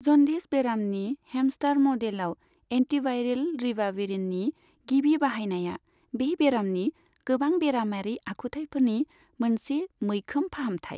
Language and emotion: Bodo, neutral